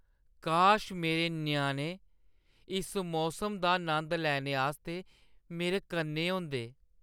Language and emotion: Dogri, sad